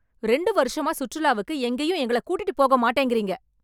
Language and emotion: Tamil, angry